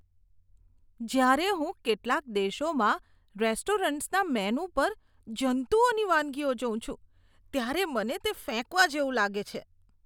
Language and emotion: Gujarati, disgusted